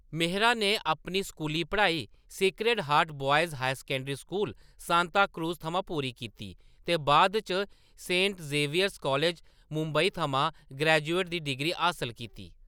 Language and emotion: Dogri, neutral